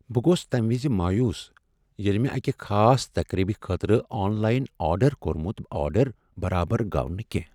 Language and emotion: Kashmiri, sad